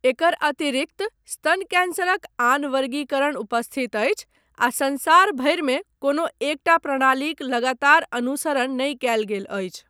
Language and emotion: Maithili, neutral